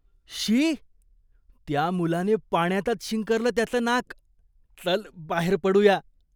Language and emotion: Marathi, disgusted